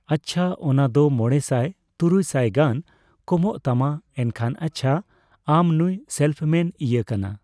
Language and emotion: Santali, neutral